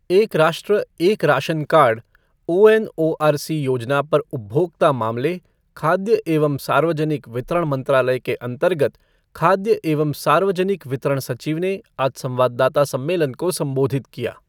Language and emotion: Hindi, neutral